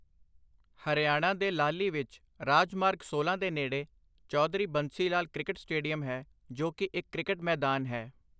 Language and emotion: Punjabi, neutral